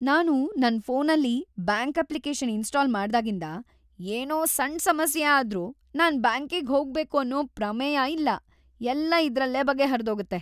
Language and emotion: Kannada, happy